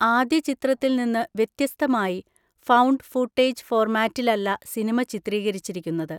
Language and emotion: Malayalam, neutral